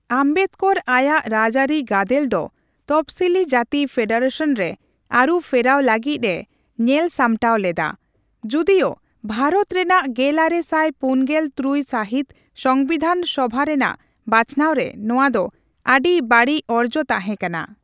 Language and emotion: Santali, neutral